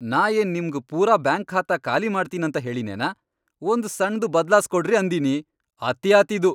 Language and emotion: Kannada, angry